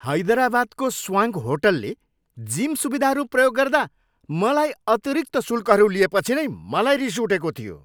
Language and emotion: Nepali, angry